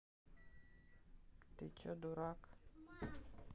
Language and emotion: Russian, neutral